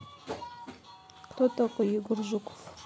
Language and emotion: Russian, neutral